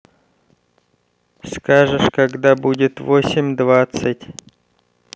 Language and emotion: Russian, neutral